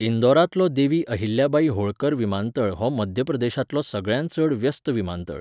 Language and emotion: Goan Konkani, neutral